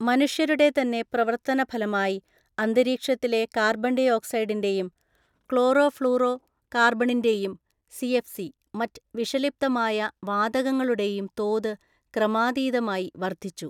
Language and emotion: Malayalam, neutral